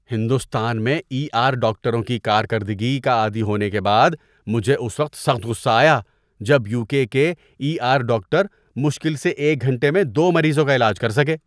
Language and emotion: Urdu, disgusted